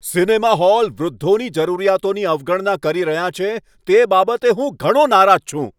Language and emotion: Gujarati, angry